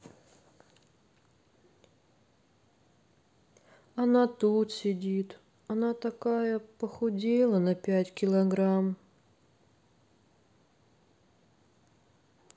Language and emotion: Russian, sad